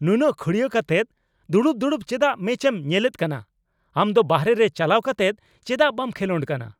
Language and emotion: Santali, angry